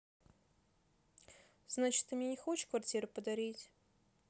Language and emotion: Russian, neutral